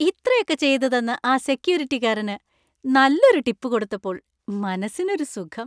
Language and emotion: Malayalam, happy